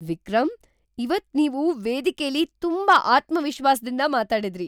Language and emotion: Kannada, surprised